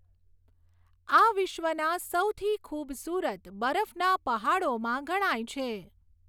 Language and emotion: Gujarati, neutral